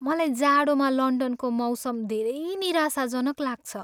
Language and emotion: Nepali, sad